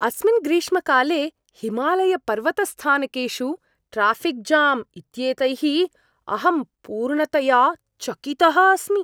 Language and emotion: Sanskrit, surprised